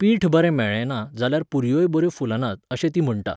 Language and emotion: Goan Konkani, neutral